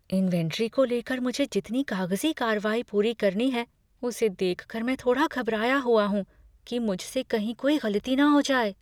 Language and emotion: Hindi, fearful